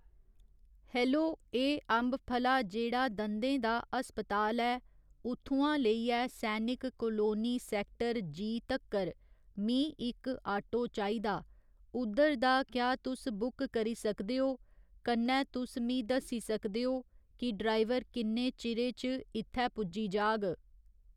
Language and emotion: Dogri, neutral